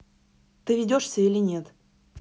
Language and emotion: Russian, neutral